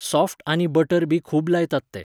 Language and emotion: Goan Konkani, neutral